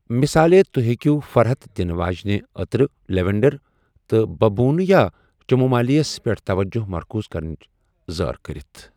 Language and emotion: Kashmiri, neutral